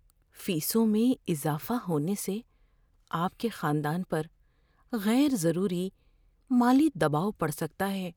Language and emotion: Urdu, fearful